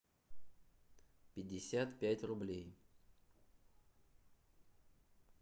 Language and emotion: Russian, neutral